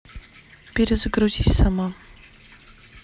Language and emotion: Russian, neutral